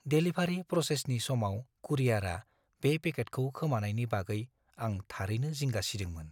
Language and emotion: Bodo, fearful